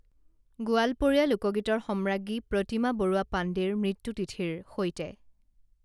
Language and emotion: Assamese, neutral